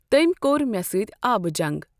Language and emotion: Kashmiri, neutral